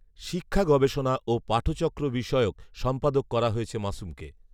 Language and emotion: Bengali, neutral